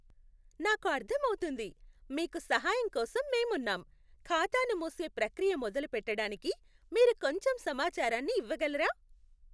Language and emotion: Telugu, happy